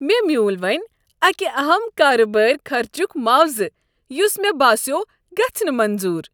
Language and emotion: Kashmiri, happy